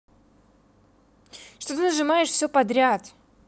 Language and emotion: Russian, angry